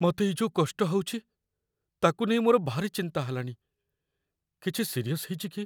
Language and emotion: Odia, fearful